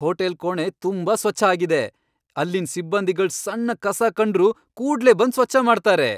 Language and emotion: Kannada, happy